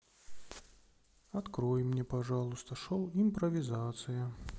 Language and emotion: Russian, sad